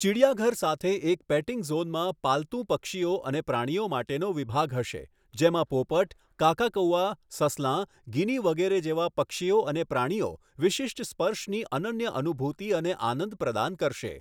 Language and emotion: Gujarati, neutral